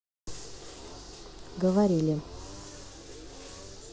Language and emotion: Russian, neutral